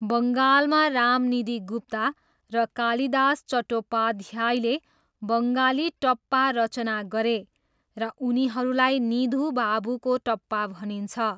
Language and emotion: Nepali, neutral